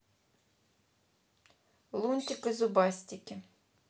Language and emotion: Russian, neutral